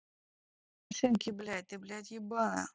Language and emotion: Russian, angry